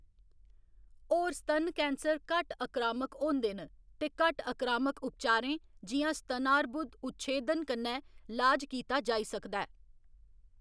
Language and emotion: Dogri, neutral